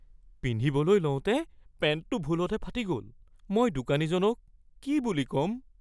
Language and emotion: Assamese, fearful